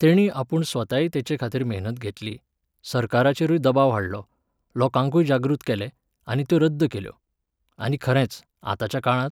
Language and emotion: Goan Konkani, neutral